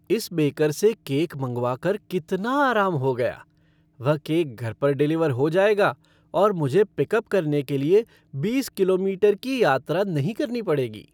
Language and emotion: Hindi, happy